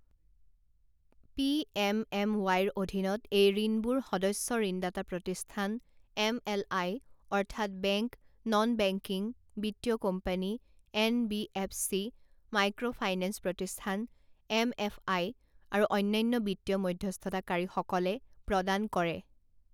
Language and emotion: Assamese, neutral